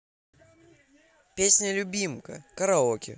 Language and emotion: Russian, positive